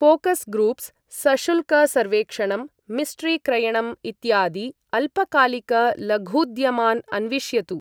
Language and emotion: Sanskrit, neutral